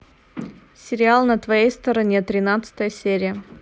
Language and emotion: Russian, neutral